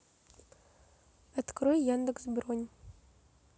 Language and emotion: Russian, neutral